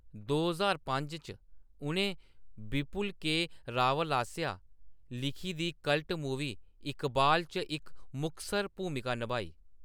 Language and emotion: Dogri, neutral